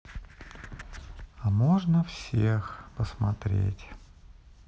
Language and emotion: Russian, sad